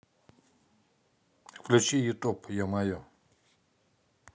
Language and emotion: Russian, neutral